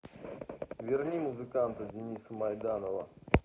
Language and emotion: Russian, neutral